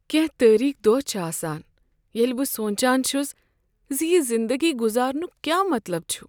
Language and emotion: Kashmiri, sad